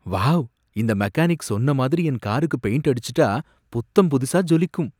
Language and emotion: Tamil, happy